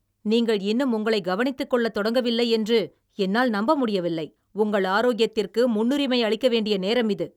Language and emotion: Tamil, angry